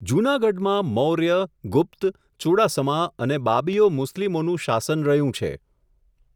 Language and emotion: Gujarati, neutral